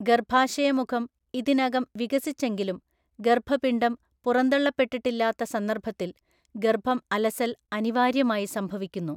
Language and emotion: Malayalam, neutral